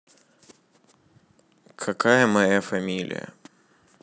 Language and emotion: Russian, neutral